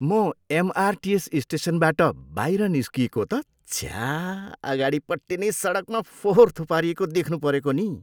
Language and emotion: Nepali, disgusted